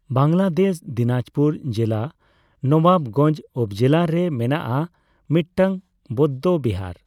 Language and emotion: Santali, neutral